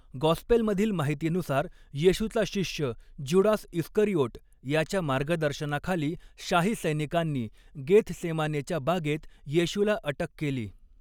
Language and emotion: Marathi, neutral